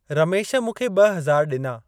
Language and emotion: Sindhi, neutral